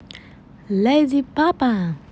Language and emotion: Russian, positive